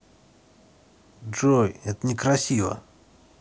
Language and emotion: Russian, neutral